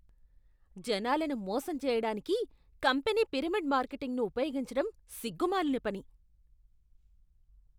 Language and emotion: Telugu, disgusted